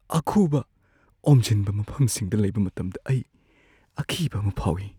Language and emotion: Manipuri, fearful